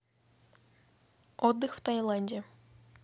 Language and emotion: Russian, neutral